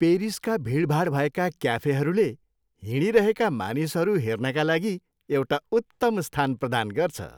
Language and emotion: Nepali, happy